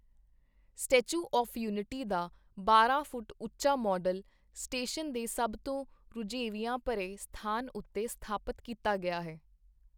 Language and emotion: Punjabi, neutral